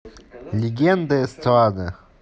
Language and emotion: Russian, neutral